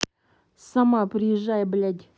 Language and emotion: Russian, angry